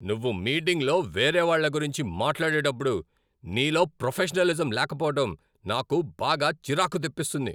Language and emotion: Telugu, angry